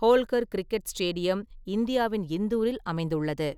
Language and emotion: Tamil, neutral